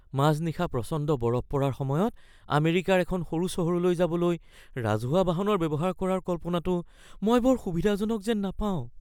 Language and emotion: Assamese, fearful